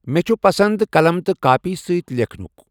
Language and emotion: Kashmiri, neutral